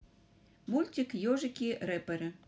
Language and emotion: Russian, neutral